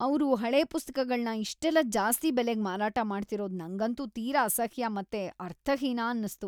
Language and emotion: Kannada, disgusted